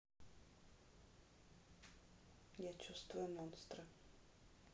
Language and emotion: Russian, neutral